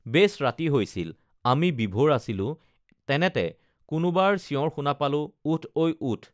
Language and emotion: Assamese, neutral